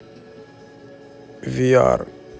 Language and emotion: Russian, neutral